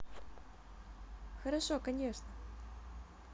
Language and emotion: Russian, positive